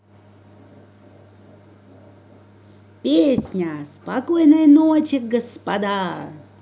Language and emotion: Russian, positive